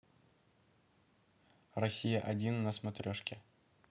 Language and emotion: Russian, neutral